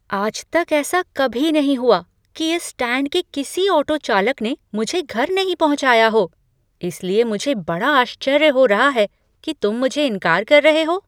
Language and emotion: Hindi, surprised